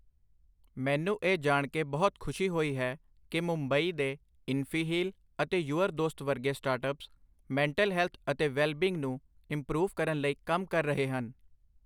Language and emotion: Punjabi, neutral